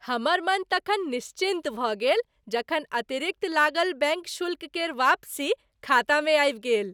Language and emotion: Maithili, happy